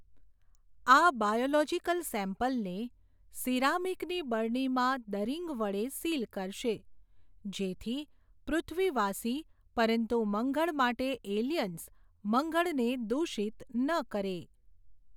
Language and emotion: Gujarati, neutral